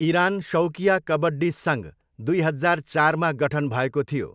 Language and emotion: Nepali, neutral